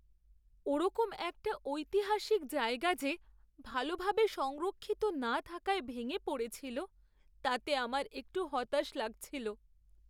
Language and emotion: Bengali, sad